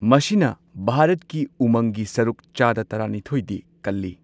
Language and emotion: Manipuri, neutral